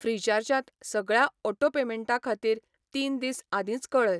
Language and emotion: Goan Konkani, neutral